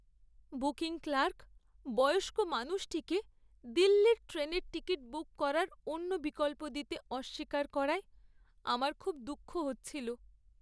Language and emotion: Bengali, sad